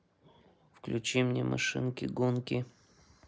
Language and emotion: Russian, neutral